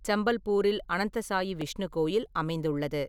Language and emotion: Tamil, neutral